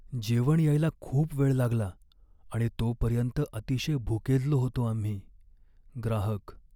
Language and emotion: Marathi, sad